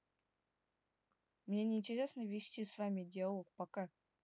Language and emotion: Russian, neutral